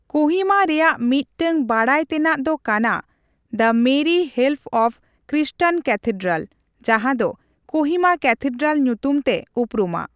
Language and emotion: Santali, neutral